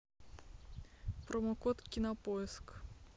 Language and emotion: Russian, neutral